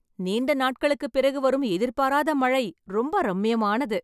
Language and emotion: Tamil, happy